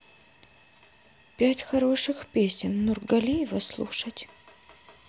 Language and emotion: Russian, neutral